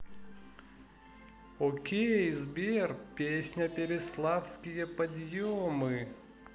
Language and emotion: Russian, positive